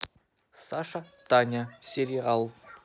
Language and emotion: Russian, neutral